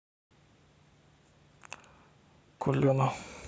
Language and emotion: Russian, neutral